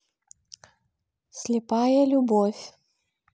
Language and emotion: Russian, neutral